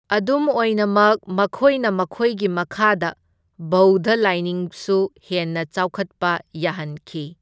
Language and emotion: Manipuri, neutral